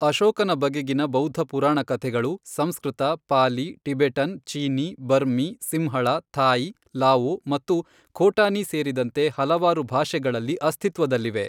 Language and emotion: Kannada, neutral